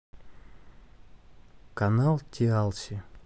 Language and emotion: Russian, neutral